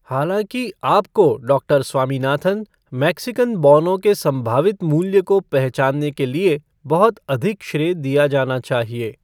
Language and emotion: Hindi, neutral